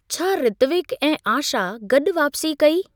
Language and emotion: Sindhi, neutral